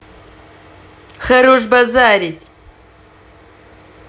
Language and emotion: Russian, angry